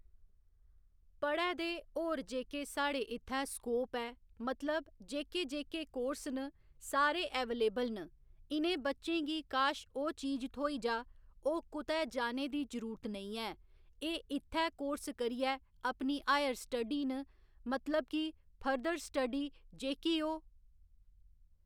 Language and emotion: Dogri, neutral